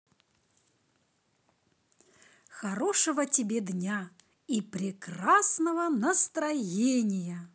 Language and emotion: Russian, positive